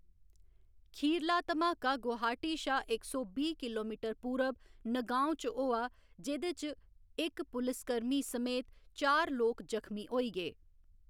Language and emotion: Dogri, neutral